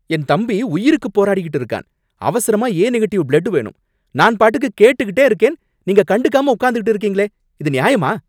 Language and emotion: Tamil, angry